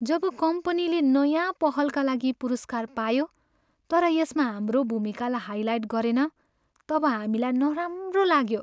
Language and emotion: Nepali, sad